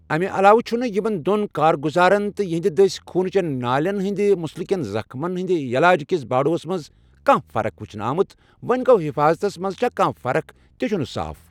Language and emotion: Kashmiri, neutral